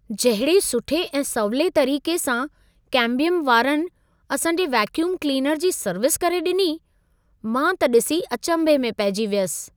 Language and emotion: Sindhi, surprised